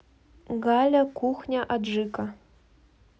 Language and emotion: Russian, neutral